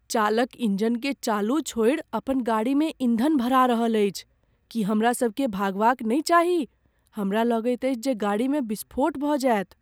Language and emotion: Maithili, fearful